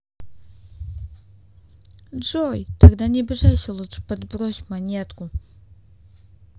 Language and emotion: Russian, neutral